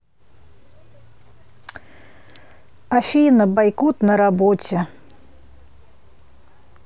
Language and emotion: Russian, sad